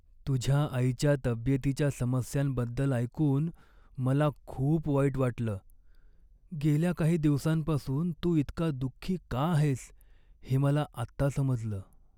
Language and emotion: Marathi, sad